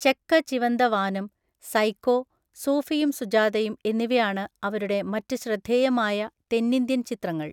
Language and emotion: Malayalam, neutral